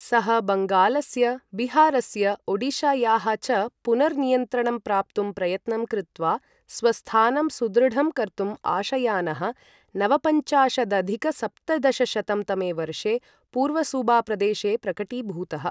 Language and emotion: Sanskrit, neutral